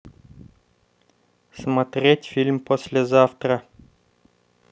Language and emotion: Russian, neutral